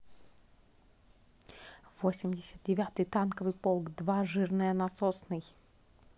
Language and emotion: Russian, positive